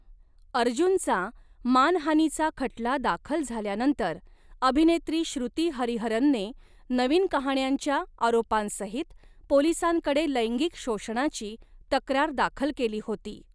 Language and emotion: Marathi, neutral